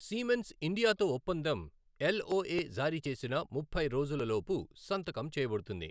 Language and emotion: Telugu, neutral